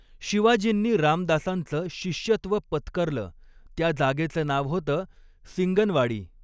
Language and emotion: Marathi, neutral